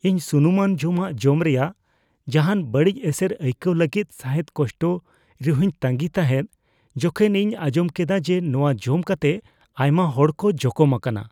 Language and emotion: Santali, fearful